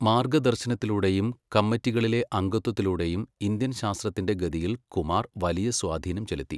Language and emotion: Malayalam, neutral